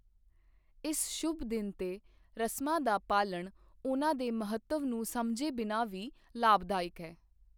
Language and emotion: Punjabi, neutral